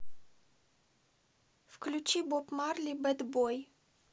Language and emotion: Russian, neutral